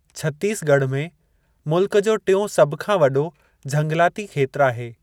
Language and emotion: Sindhi, neutral